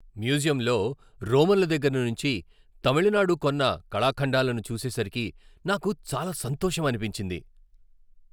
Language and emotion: Telugu, happy